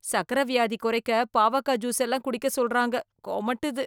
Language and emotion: Tamil, disgusted